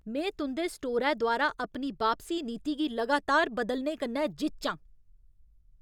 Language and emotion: Dogri, angry